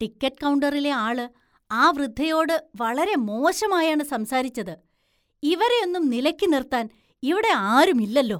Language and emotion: Malayalam, disgusted